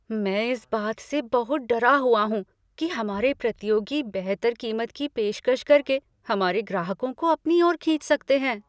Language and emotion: Hindi, fearful